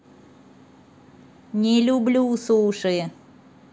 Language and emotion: Russian, neutral